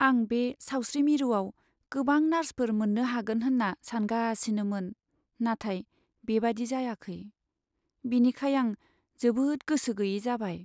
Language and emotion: Bodo, sad